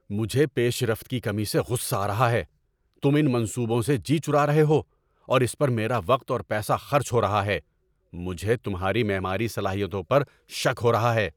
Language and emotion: Urdu, angry